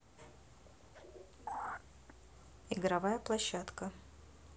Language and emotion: Russian, neutral